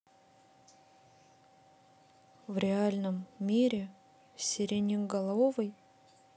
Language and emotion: Russian, neutral